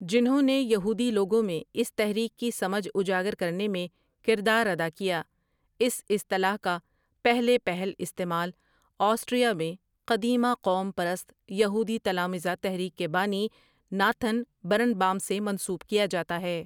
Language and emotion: Urdu, neutral